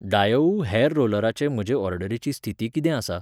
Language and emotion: Goan Konkani, neutral